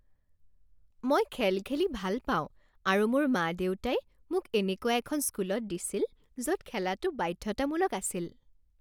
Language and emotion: Assamese, happy